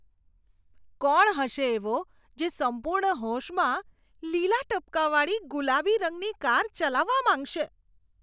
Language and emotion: Gujarati, disgusted